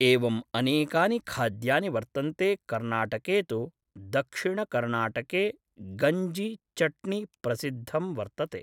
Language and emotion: Sanskrit, neutral